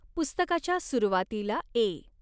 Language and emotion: Marathi, neutral